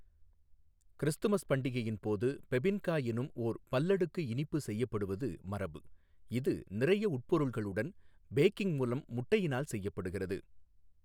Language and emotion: Tamil, neutral